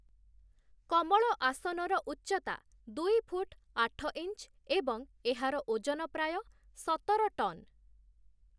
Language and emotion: Odia, neutral